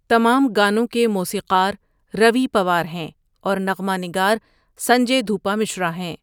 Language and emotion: Urdu, neutral